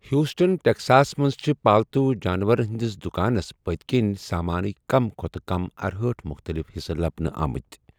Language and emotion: Kashmiri, neutral